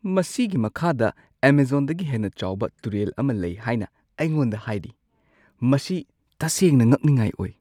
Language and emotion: Manipuri, surprised